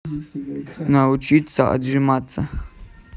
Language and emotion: Russian, neutral